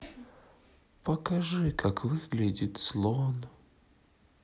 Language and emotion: Russian, sad